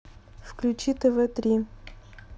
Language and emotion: Russian, neutral